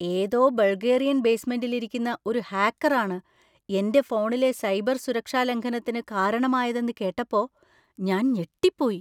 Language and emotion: Malayalam, surprised